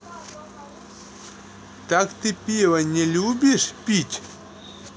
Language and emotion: Russian, neutral